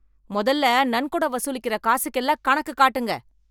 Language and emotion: Tamil, angry